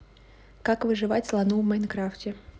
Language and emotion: Russian, neutral